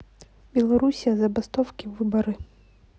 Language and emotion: Russian, neutral